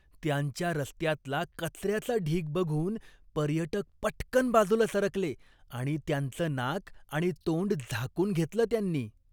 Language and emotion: Marathi, disgusted